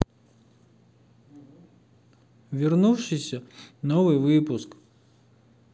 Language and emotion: Russian, sad